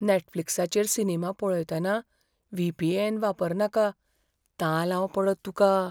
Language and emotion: Goan Konkani, fearful